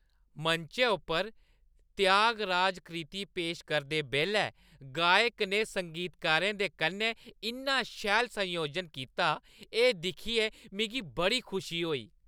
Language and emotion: Dogri, happy